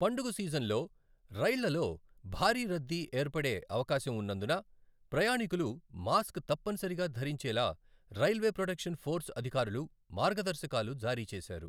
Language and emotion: Telugu, neutral